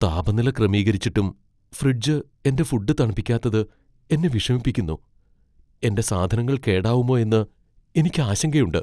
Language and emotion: Malayalam, fearful